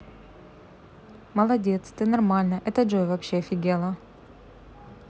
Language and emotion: Russian, neutral